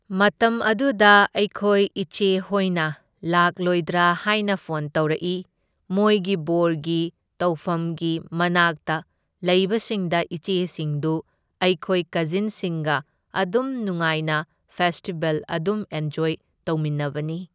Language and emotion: Manipuri, neutral